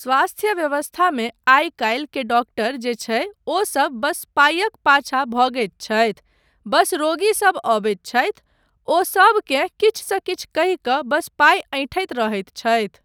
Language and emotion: Maithili, neutral